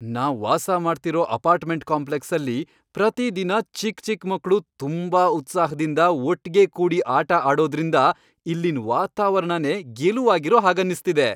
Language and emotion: Kannada, happy